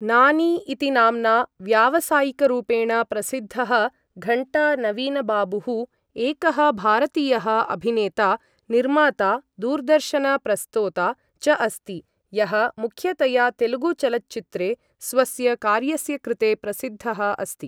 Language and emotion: Sanskrit, neutral